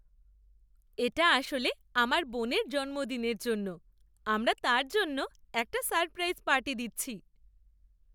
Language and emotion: Bengali, happy